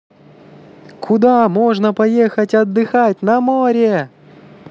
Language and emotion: Russian, positive